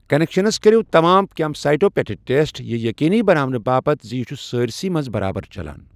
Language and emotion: Kashmiri, neutral